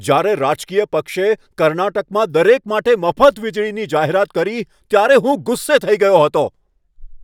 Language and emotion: Gujarati, angry